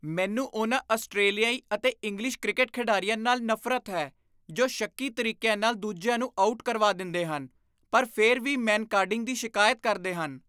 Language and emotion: Punjabi, disgusted